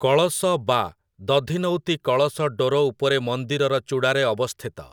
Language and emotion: Odia, neutral